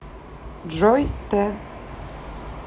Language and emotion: Russian, neutral